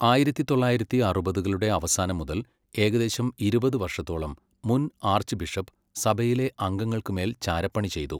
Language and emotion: Malayalam, neutral